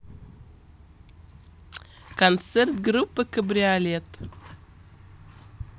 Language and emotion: Russian, positive